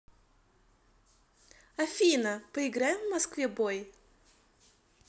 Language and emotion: Russian, positive